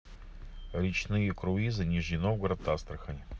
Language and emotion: Russian, neutral